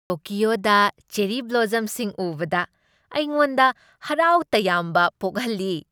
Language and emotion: Manipuri, happy